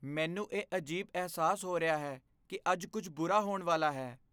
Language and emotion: Punjabi, fearful